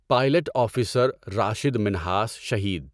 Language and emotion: Urdu, neutral